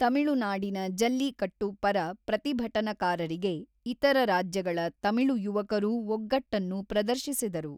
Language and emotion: Kannada, neutral